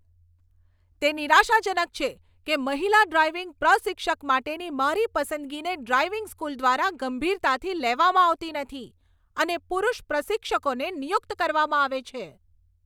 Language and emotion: Gujarati, angry